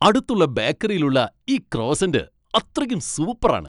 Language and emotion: Malayalam, happy